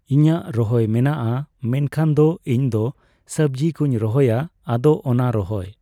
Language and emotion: Santali, neutral